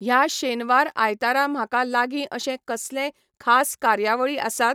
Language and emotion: Goan Konkani, neutral